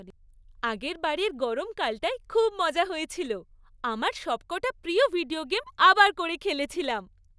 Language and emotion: Bengali, happy